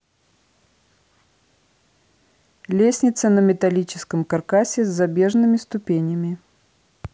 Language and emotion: Russian, neutral